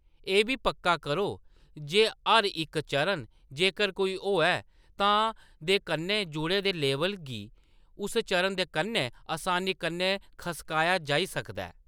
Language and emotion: Dogri, neutral